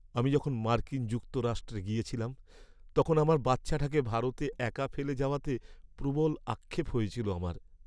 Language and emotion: Bengali, sad